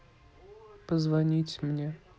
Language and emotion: Russian, neutral